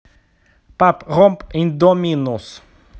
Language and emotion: Russian, neutral